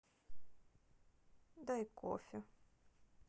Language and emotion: Russian, neutral